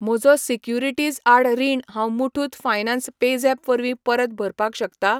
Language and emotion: Goan Konkani, neutral